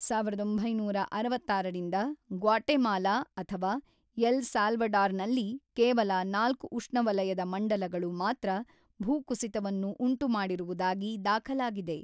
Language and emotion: Kannada, neutral